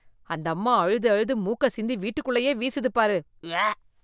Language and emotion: Tamil, disgusted